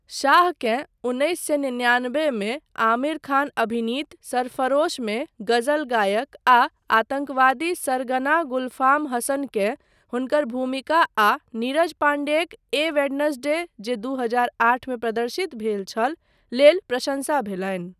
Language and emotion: Maithili, neutral